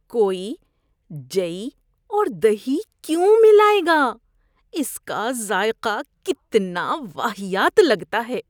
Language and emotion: Urdu, disgusted